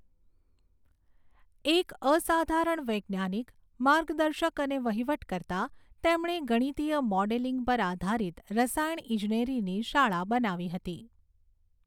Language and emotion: Gujarati, neutral